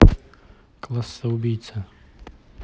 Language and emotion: Russian, neutral